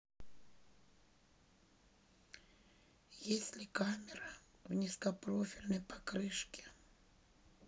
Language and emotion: Russian, neutral